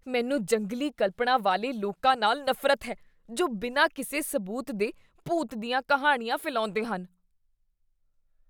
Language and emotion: Punjabi, disgusted